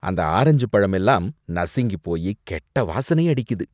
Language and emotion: Tamil, disgusted